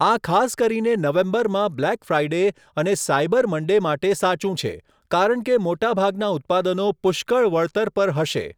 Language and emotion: Gujarati, neutral